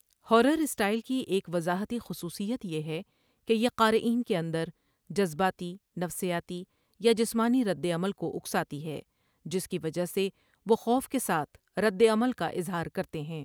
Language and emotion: Urdu, neutral